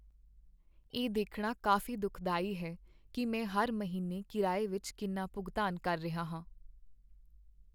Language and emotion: Punjabi, sad